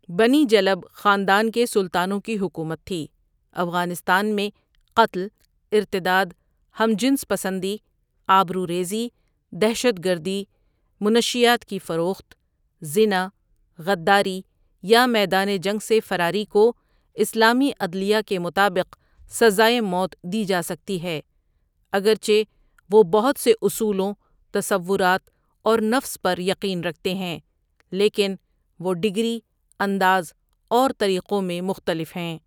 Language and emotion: Urdu, neutral